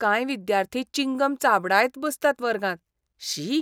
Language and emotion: Goan Konkani, disgusted